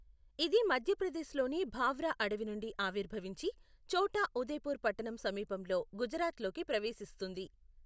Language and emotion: Telugu, neutral